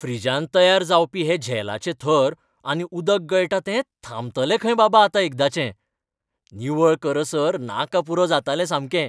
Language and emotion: Goan Konkani, happy